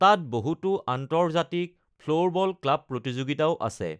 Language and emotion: Assamese, neutral